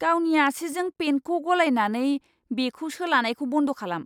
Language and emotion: Bodo, disgusted